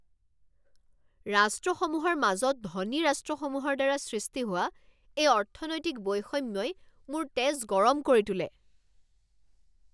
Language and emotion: Assamese, angry